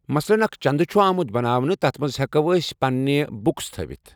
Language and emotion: Kashmiri, neutral